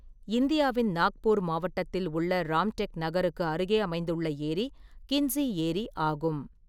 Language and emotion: Tamil, neutral